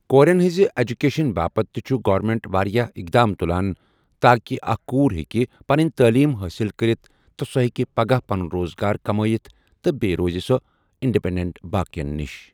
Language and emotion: Kashmiri, neutral